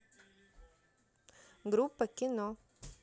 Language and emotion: Russian, neutral